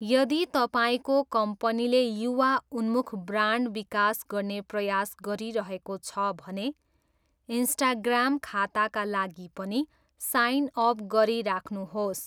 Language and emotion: Nepali, neutral